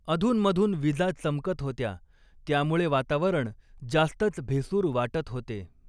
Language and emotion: Marathi, neutral